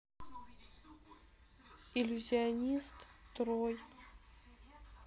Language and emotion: Russian, sad